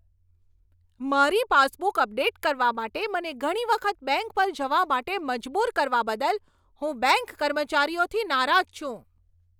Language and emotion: Gujarati, angry